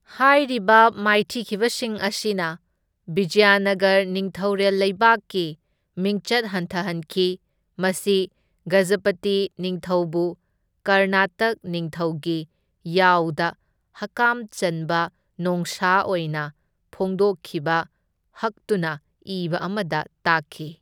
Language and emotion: Manipuri, neutral